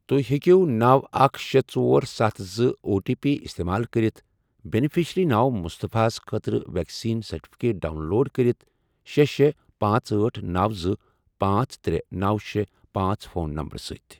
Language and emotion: Kashmiri, neutral